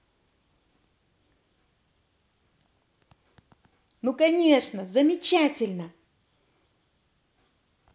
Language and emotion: Russian, positive